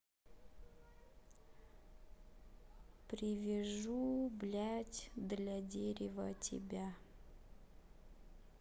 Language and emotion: Russian, sad